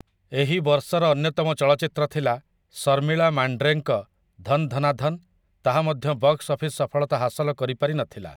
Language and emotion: Odia, neutral